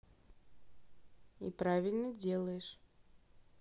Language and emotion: Russian, neutral